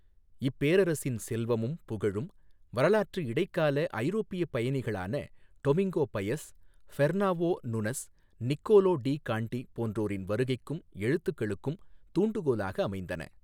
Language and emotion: Tamil, neutral